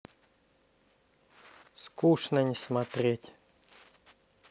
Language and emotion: Russian, neutral